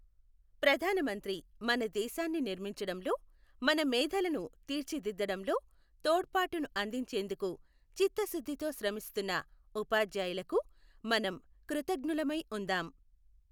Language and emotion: Telugu, neutral